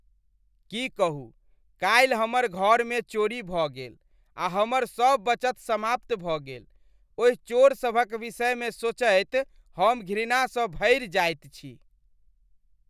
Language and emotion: Maithili, disgusted